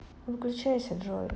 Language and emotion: Russian, neutral